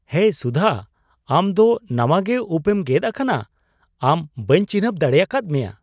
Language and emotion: Santali, surprised